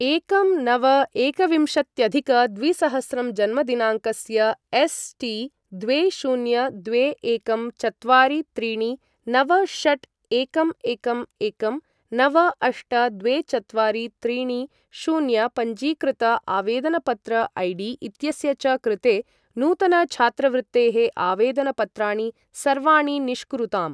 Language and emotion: Sanskrit, neutral